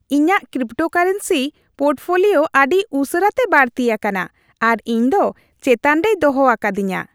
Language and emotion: Santali, happy